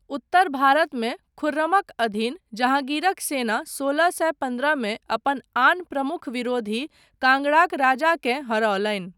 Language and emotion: Maithili, neutral